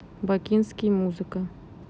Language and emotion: Russian, neutral